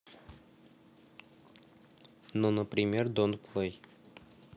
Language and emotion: Russian, neutral